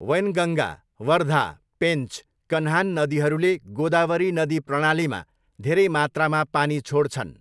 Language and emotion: Nepali, neutral